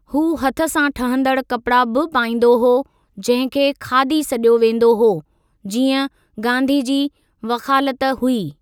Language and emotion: Sindhi, neutral